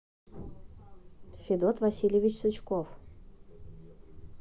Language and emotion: Russian, neutral